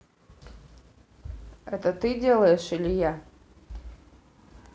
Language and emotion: Russian, neutral